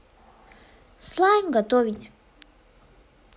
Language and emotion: Russian, neutral